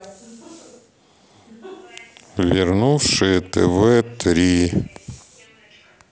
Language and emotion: Russian, neutral